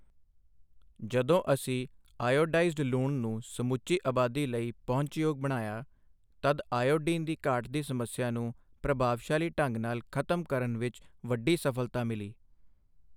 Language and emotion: Punjabi, neutral